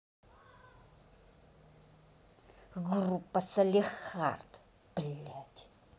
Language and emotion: Russian, angry